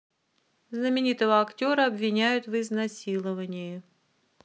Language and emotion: Russian, neutral